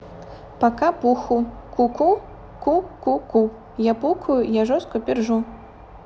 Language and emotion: Russian, positive